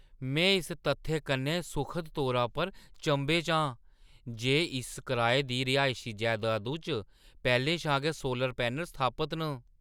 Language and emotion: Dogri, surprised